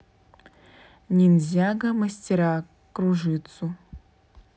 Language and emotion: Russian, neutral